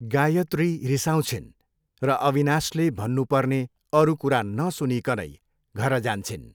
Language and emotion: Nepali, neutral